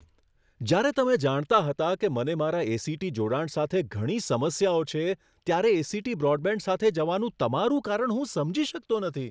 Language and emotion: Gujarati, surprised